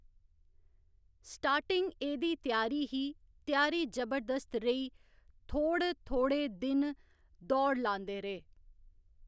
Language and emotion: Dogri, neutral